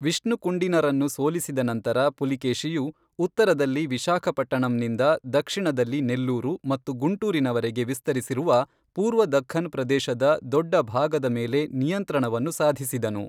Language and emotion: Kannada, neutral